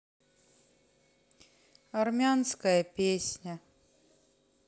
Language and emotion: Russian, sad